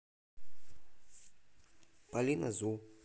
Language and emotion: Russian, neutral